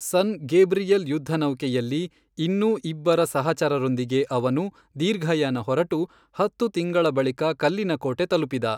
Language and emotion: Kannada, neutral